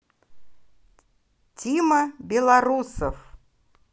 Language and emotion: Russian, positive